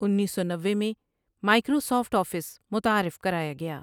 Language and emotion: Urdu, neutral